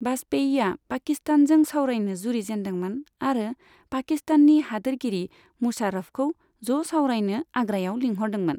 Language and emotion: Bodo, neutral